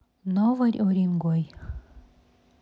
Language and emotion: Russian, neutral